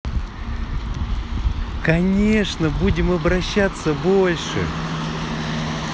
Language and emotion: Russian, positive